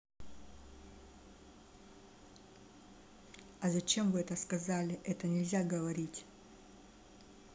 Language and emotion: Russian, neutral